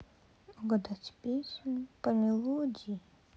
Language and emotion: Russian, sad